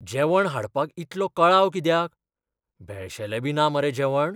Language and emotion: Goan Konkani, fearful